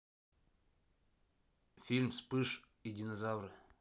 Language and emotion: Russian, neutral